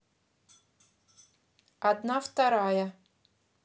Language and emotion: Russian, neutral